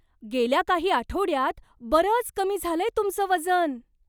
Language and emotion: Marathi, surprised